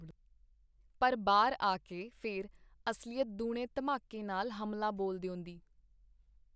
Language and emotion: Punjabi, neutral